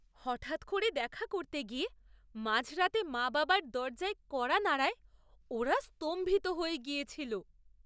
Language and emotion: Bengali, surprised